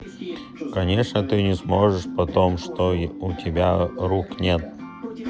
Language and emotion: Russian, neutral